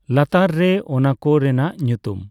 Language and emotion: Santali, neutral